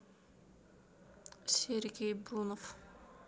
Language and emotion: Russian, neutral